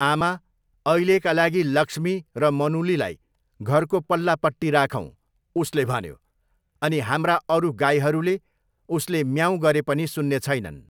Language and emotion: Nepali, neutral